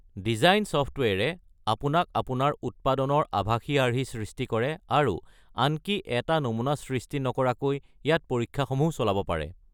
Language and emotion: Assamese, neutral